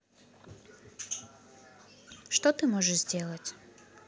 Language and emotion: Russian, neutral